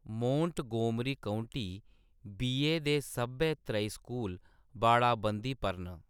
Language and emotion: Dogri, neutral